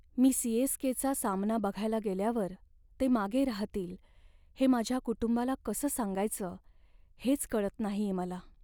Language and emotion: Marathi, sad